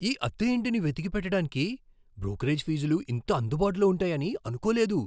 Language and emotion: Telugu, surprised